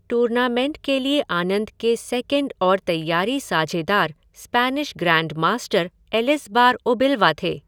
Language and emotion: Hindi, neutral